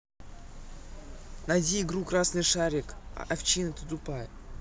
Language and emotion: Russian, angry